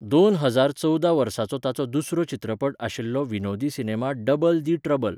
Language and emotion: Goan Konkani, neutral